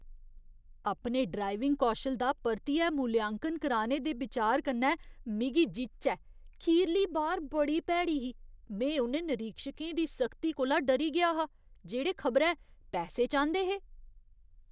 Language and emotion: Dogri, disgusted